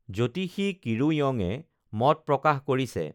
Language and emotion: Assamese, neutral